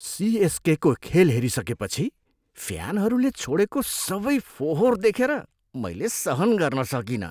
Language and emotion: Nepali, disgusted